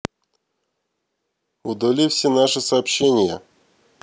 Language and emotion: Russian, neutral